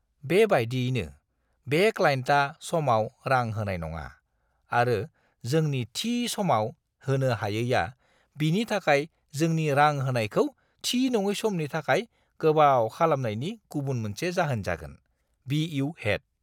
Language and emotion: Bodo, disgusted